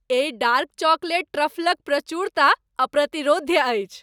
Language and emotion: Maithili, happy